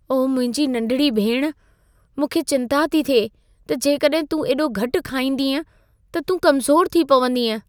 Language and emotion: Sindhi, fearful